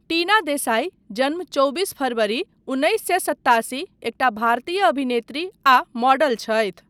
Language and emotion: Maithili, neutral